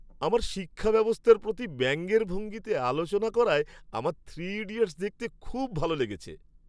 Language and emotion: Bengali, happy